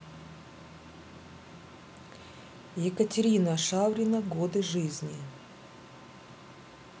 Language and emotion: Russian, neutral